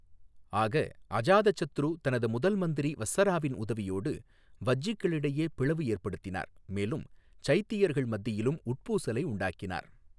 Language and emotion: Tamil, neutral